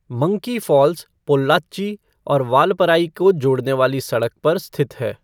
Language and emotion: Hindi, neutral